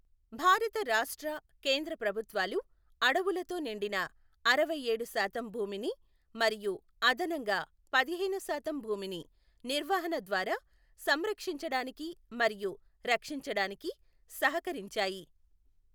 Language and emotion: Telugu, neutral